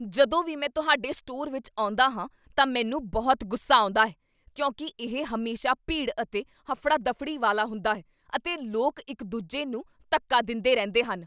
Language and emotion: Punjabi, angry